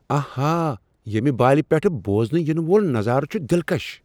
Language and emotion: Kashmiri, surprised